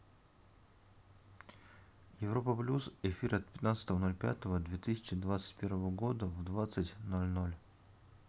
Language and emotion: Russian, neutral